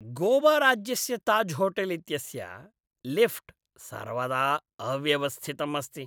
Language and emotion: Sanskrit, disgusted